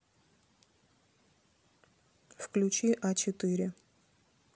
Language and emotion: Russian, neutral